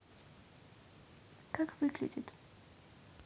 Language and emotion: Russian, neutral